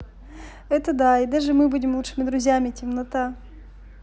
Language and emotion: Russian, neutral